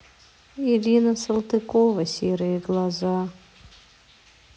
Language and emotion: Russian, sad